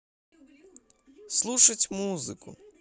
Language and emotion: Russian, positive